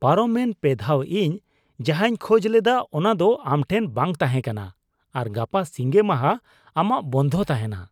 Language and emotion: Santali, disgusted